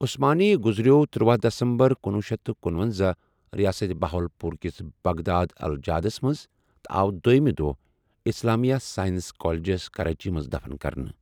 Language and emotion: Kashmiri, neutral